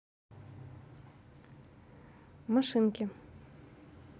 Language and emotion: Russian, neutral